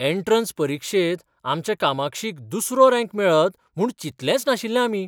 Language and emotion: Goan Konkani, surprised